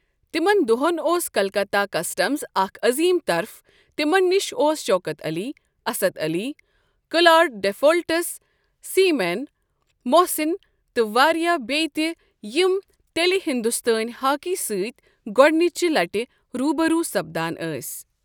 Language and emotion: Kashmiri, neutral